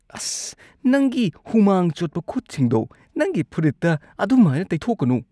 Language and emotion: Manipuri, disgusted